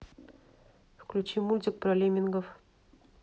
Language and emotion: Russian, neutral